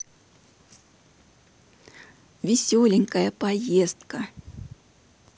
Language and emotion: Russian, positive